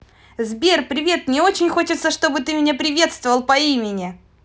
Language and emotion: Russian, positive